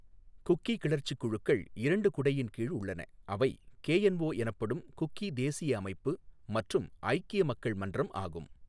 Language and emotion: Tamil, neutral